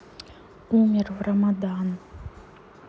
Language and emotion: Russian, neutral